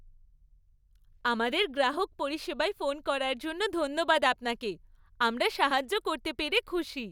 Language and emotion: Bengali, happy